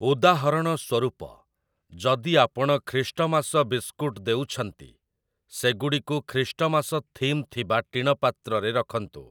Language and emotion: Odia, neutral